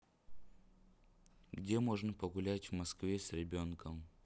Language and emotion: Russian, neutral